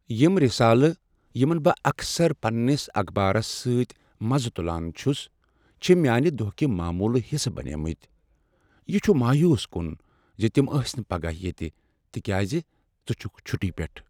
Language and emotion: Kashmiri, sad